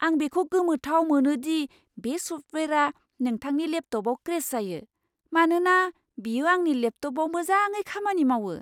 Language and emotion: Bodo, surprised